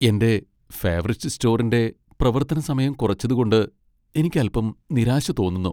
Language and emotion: Malayalam, sad